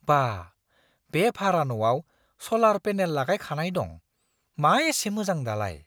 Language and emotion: Bodo, surprised